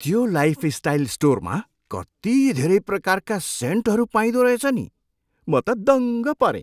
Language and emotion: Nepali, surprised